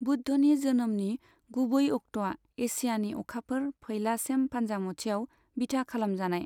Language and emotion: Bodo, neutral